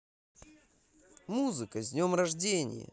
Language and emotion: Russian, positive